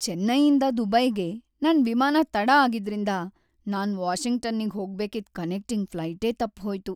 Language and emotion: Kannada, sad